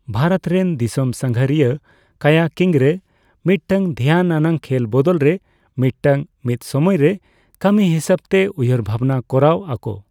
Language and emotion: Santali, neutral